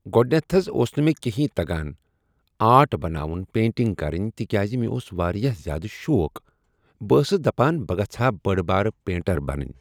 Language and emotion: Kashmiri, neutral